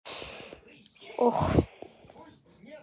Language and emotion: Russian, sad